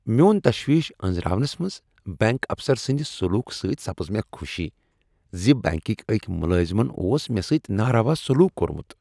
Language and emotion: Kashmiri, happy